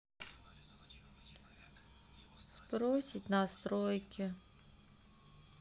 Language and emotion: Russian, sad